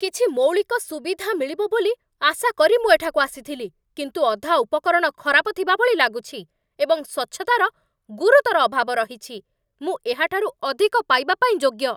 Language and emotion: Odia, angry